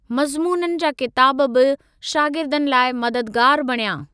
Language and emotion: Sindhi, neutral